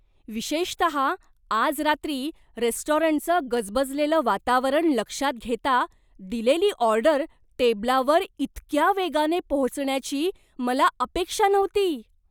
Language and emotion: Marathi, surprised